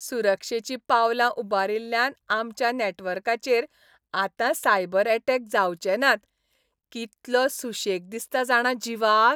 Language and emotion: Goan Konkani, happy